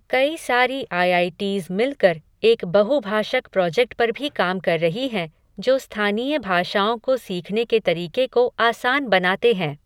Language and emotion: Hindi, neutral